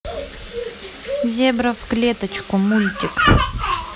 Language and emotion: Russian, neutral